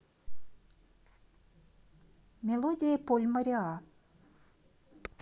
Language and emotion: Russian, neutral